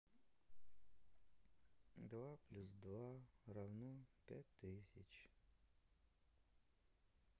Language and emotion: Russian, sad